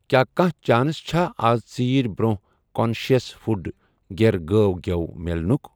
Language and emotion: Kashmiri, neutral